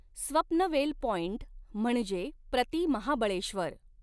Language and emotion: Marathi, neutral